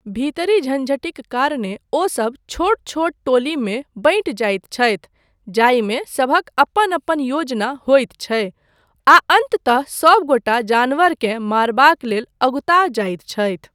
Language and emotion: Maithili, neutral